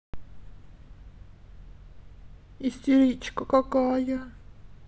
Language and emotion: Russian, sad